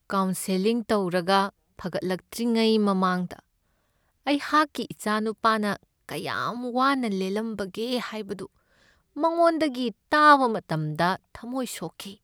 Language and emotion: Manipuri, sad